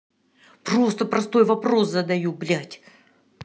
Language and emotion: Russian, angry